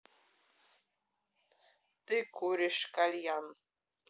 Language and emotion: Russian, neutral